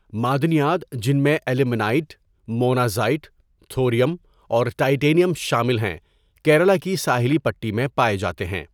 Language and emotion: Urdu, neutral